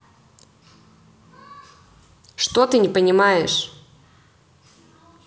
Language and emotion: Russian, angry